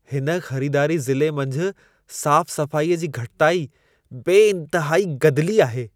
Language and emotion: Sindhi, disgusted